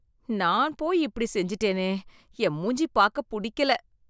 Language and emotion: Tamil, disgusted